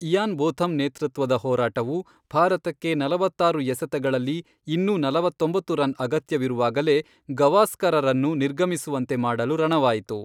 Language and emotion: Kannada, neutral